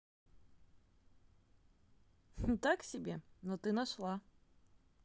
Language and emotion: Russian, positive